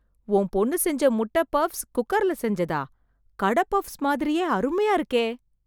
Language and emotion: Tamil, surprised